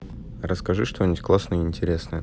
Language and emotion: Russian, neutral